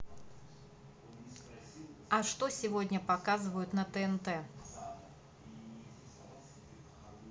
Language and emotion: Russian, neutral